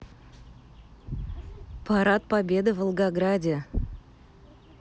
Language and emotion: Russian, neutral